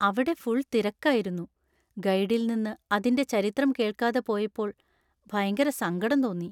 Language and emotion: Malayalam, sad